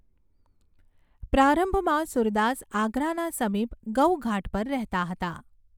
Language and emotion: Gujarati, neutral